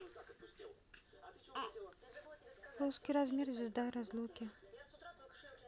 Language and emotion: Russian, neutral